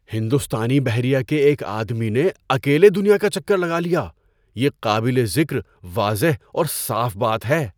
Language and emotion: Urdu, surprised